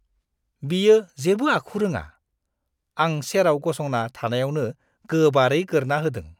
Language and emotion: Bodo, disgusted